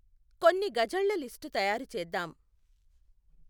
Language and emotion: Telugu, neutral